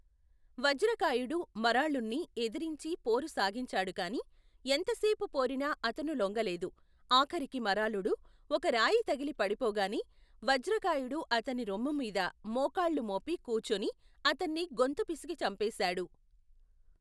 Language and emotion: Telugu, neutral